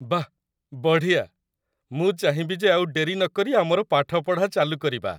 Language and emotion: Odia, happy